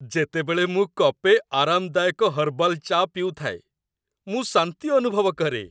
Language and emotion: Odia, happy